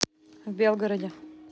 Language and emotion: Russian, neutral